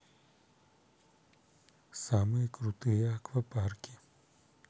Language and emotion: Russian, neutral